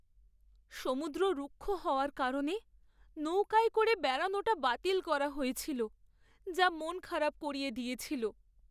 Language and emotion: Bengali, sad